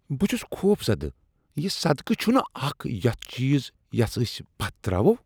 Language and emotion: Kashmiri, disgusted